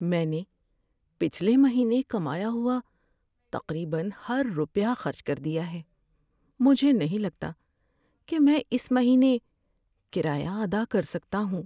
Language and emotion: Urdu, sad